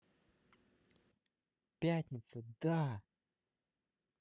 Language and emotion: Russian, positive